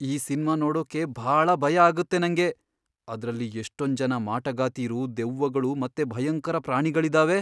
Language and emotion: Kannada, fearful